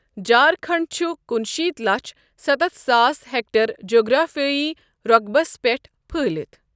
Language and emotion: Kashmiri, neutral